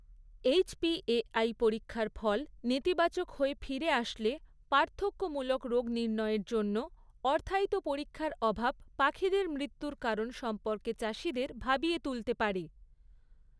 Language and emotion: Bengali, neutral